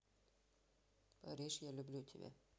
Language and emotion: Russian, neutral